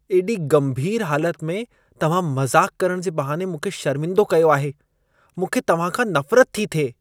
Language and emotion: Sindhi, disgusted